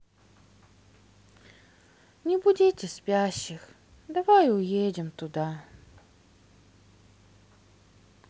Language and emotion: Russian, sad